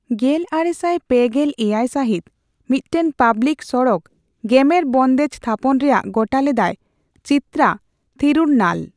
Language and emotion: Santali, neutral